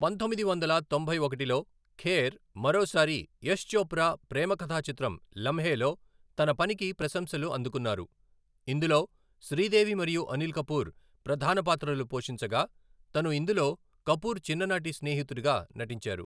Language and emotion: Telugu, neutral